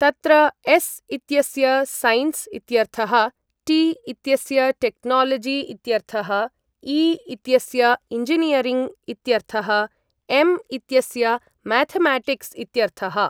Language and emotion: Sanskrit, neutral